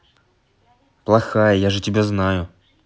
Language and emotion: Russian, angry